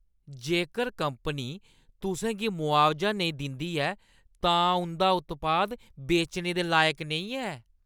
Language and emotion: Dogri, disgusted